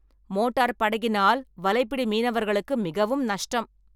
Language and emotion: Tamil, angry